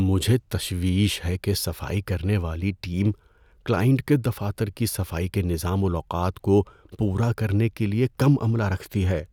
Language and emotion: Urdu, fearful